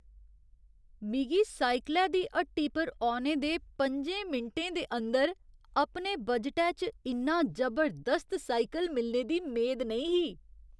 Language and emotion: Dogri, surprised